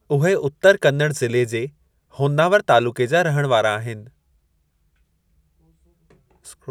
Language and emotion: Sindhi, neutral